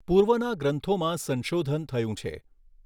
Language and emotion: Gujarati, neutral